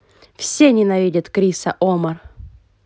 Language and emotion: Russian, angry